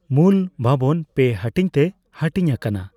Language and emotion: Santali, neutral